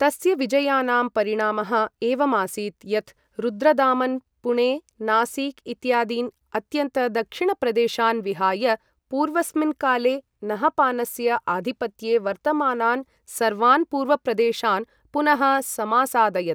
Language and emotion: Sanskrit, neutral